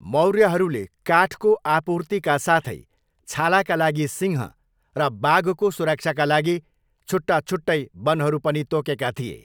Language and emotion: Nepali, neutral